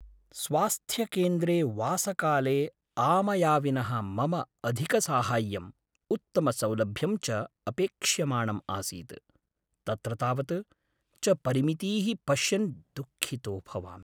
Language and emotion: Sanskrit, sad